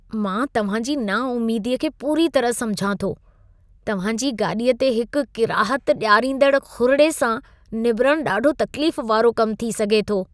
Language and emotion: Sindhi, disgusted